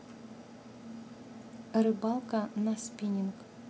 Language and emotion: Russian, neutral